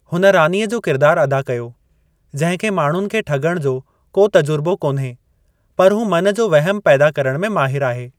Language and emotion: Sindhi, neutral